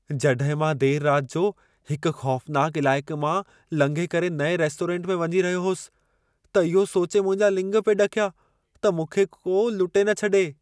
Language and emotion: Sindhi, fearful